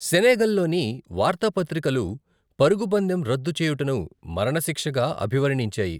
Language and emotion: Telugu, neutral